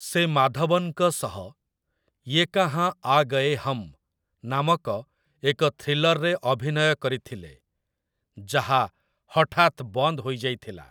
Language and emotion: Odia, neutral